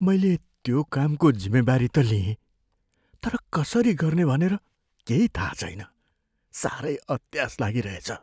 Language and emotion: Nepali, fearful